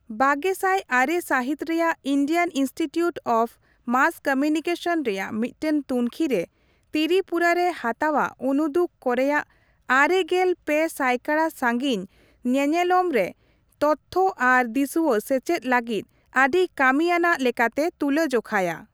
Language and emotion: Santali, neutral